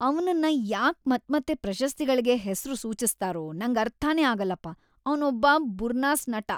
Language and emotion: Kannada, disgusted